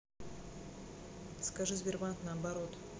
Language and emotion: Russian, neutral